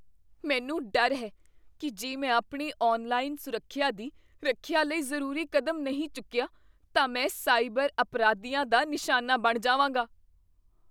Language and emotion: Punjabi, fearful